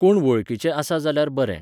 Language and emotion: Goan Konkani, neutral